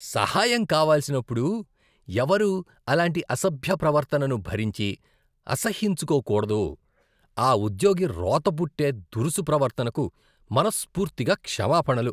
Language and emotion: Telugu, disgusted